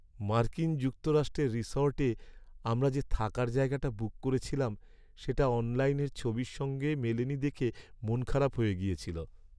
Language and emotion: Bengali, sad